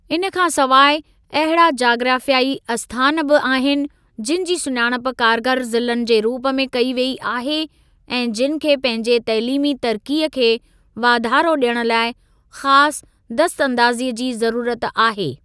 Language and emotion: Sindhi, neutral